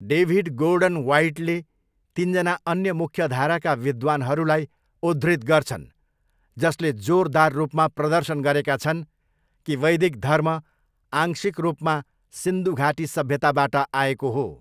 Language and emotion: Nepali, neutral